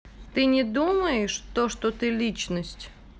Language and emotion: Russian, neutral